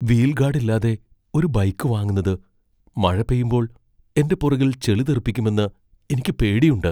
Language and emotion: Malayalam, fearful